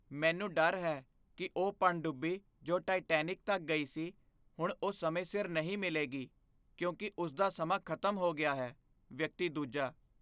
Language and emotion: Punjabi, fearful